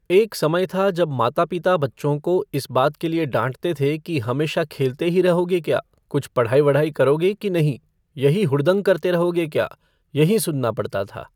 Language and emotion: Hindi, neutral